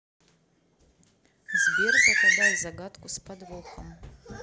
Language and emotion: Russian, neutral